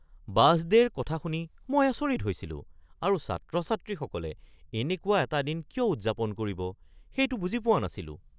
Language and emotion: Assamese, surprised